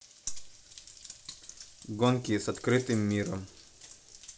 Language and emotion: Russian, neutral